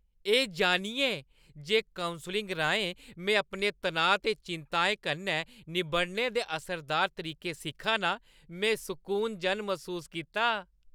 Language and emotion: Dogri, happy